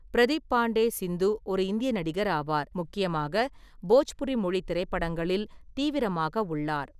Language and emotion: Tamil, neutral